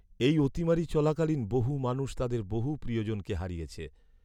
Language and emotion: Bengali, sad